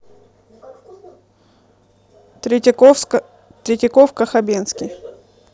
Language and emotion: Russian, neutral